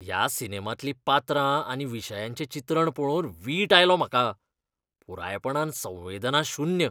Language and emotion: Goan Konkani, disgusted